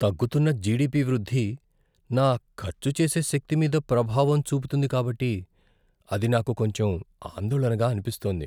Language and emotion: Telugu, fearful